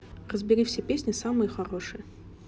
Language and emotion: Russian, neutral